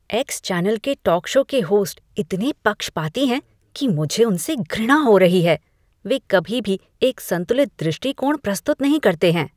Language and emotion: Hindi, disgusted